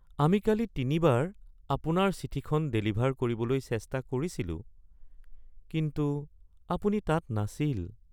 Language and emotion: Assamese, sad